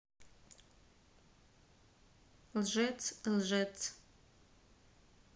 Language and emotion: Russian, neutral